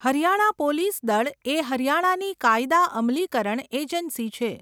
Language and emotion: Gujarati, neutral